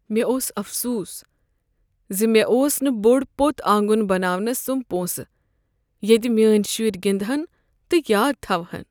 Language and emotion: Kashmiri, sad